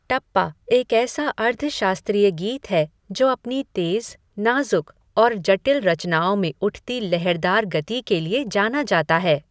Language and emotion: Hindi, neutral